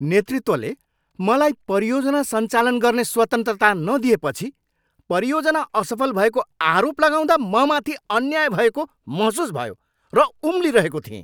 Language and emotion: Nepali, angry